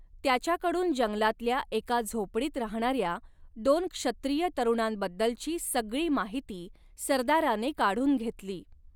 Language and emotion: Marathi, neutral